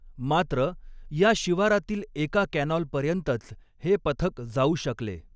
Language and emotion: Marathi, neutral